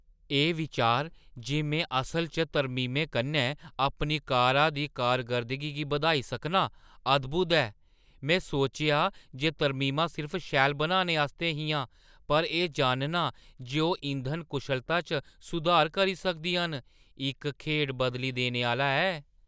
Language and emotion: Dogri, surprised